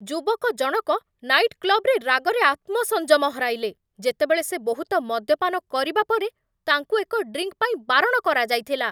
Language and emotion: Odia, angry